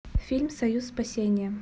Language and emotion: Russian, neutral